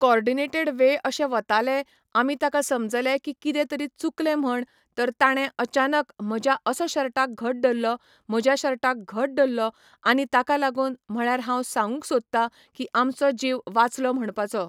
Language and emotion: Goan Konkani, neutral